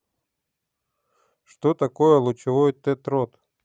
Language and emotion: Russian, neutral